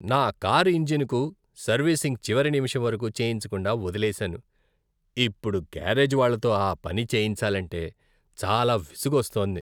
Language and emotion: Telugu, disgusted